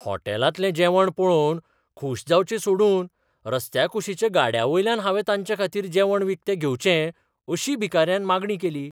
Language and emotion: Goan Konkani, surprised